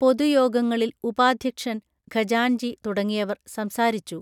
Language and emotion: Malayalam, neutral